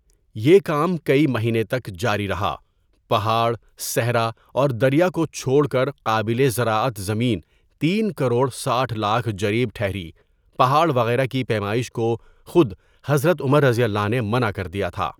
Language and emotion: Urdu, neutral